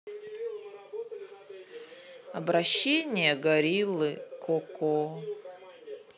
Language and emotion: Russian, sad